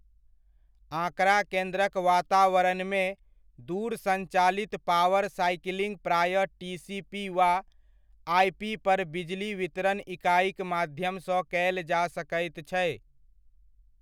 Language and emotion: Maithili, neutral